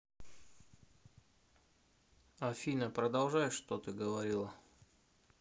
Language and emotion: Russian, neutral